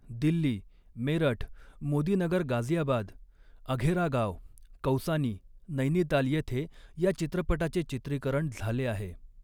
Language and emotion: Marathi, neutral